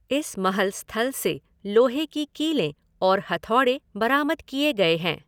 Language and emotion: Hindi, neutral